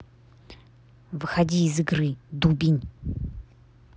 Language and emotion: Russian, angry